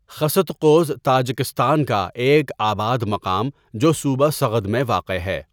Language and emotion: Urdu, neutral